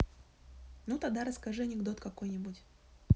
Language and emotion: Russian, neutral